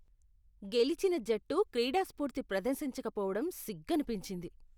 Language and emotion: Telugu, disgusted